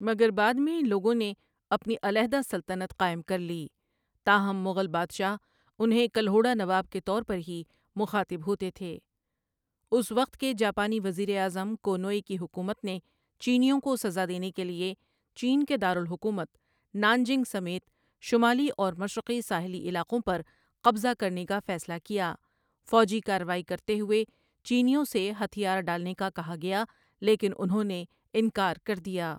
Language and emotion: Urdu, neutral